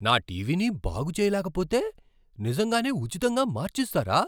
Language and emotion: Telugu, surprised